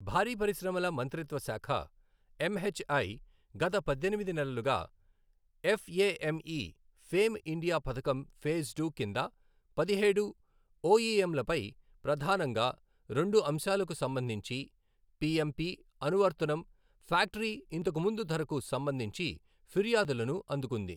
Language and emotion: Telugu, neutral